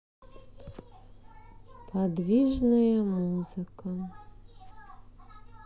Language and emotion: Russian, sad